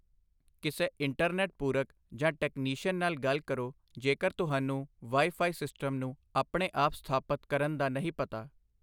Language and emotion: Punjabi, neutral